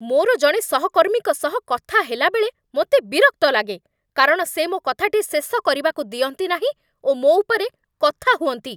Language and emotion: Odia, angry